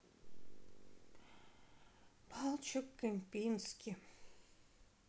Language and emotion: Russian, sad